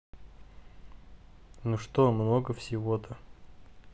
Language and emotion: Russian, neutral